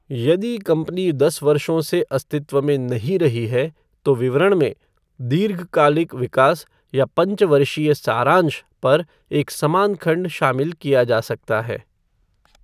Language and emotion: Hindi, neutral